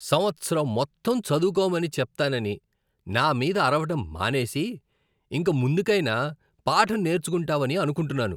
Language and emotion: Telugu, disgusted